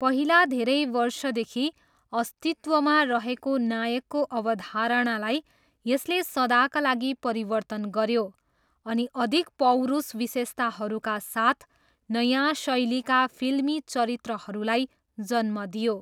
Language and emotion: Nepali, neutral